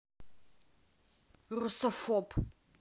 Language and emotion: Russian, angry